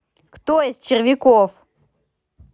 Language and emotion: Russian, angry